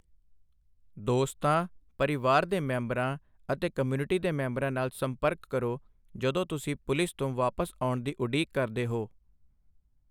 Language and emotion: Punjabi, neutral